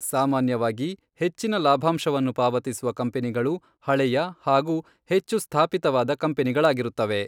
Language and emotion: Kannada, neutral